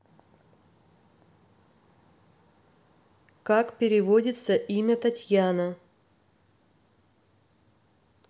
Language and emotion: Russian, neutral